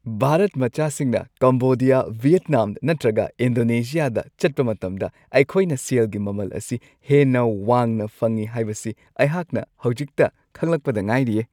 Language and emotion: Manipuri, happy